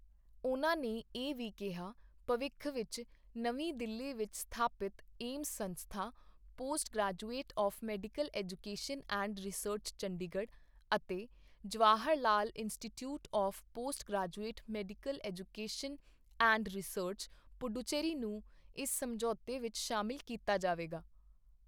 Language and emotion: Punjabi, neutral